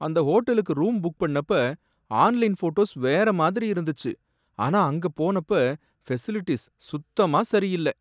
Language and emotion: Tamil, sad